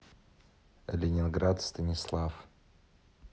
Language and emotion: Russian, neutral